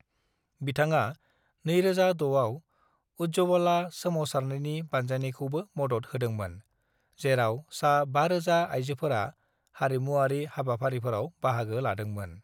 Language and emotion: Bodo, neutral